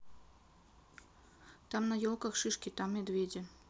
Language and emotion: Russian, neutral